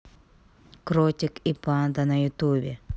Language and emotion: Russian, neutral